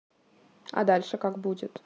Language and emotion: Russian, neutral